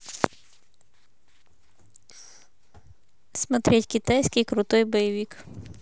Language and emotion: Russian, neutral